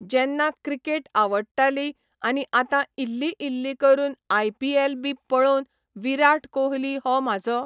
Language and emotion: Goan Konkani, neutral